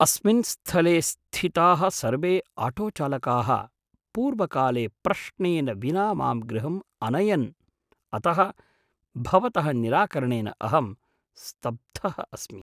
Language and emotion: Sanskrit, surprised